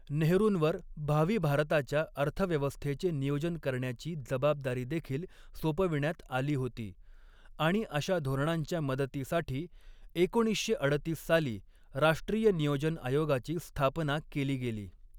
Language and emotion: Marathi, neutral